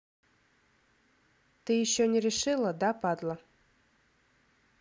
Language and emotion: Russian, angry